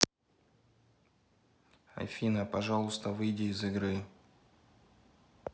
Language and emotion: Russian, neutral